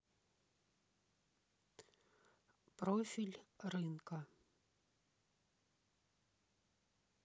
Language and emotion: Russian, neutral